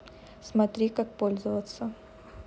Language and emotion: Russian, neutral